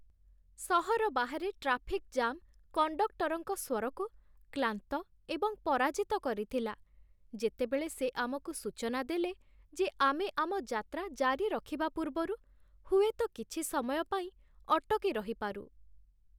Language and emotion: Odia, sad